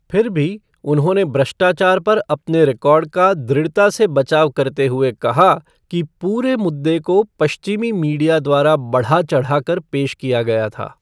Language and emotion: Hindi, neutral